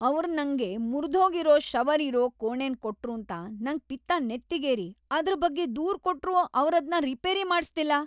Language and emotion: Kannada, angry